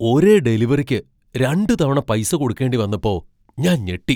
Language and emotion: Malayalam, surprised